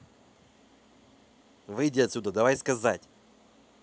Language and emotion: Russian, angry